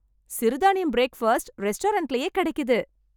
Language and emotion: Tamil, happy